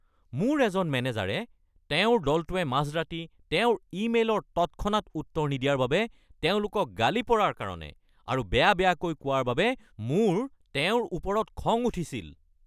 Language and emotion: Assamese, angry